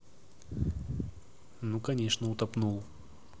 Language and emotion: Russian, neutral